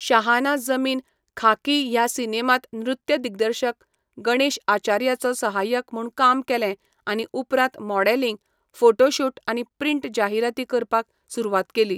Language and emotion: Goan Konkani, neutral